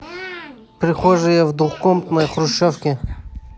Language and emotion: Russian, neutral